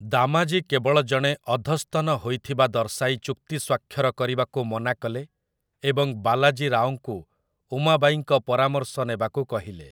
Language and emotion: Odia, neutral